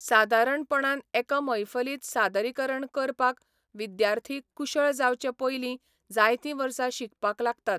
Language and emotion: Goan Konkani, neutral